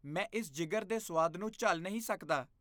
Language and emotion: Punjabi, disgusted